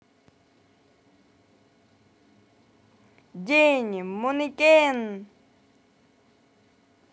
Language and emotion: Russian, positive